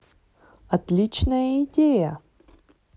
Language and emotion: Russian, positive